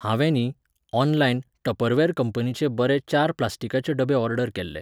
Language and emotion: Goan Konkani, neutral